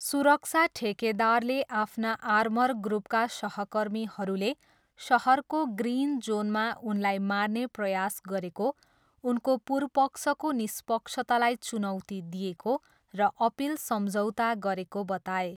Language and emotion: Nepali, neutral